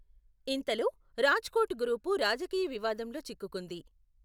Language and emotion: Telugu, neutral